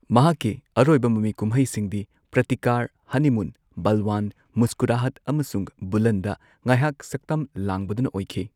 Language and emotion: Manipuri, neutral